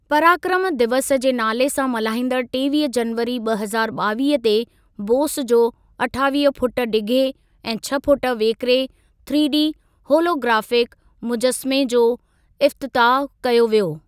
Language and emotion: Sindhi, neutral